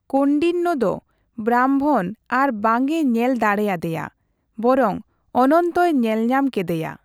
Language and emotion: Santali, neutral